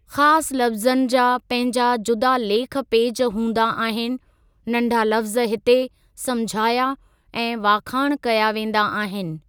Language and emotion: Sindhi, neutral